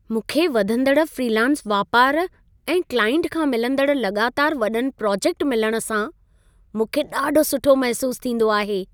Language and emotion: Sindhi, happy